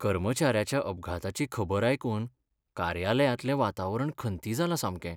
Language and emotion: Goan Konkani, sad